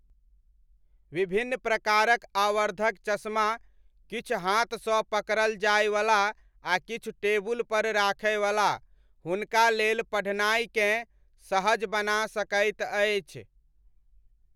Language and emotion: Maithili, neutral